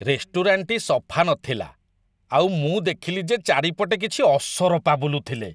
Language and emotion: Odia, disgusted